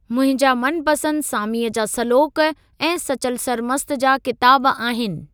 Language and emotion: Sindhi, neutral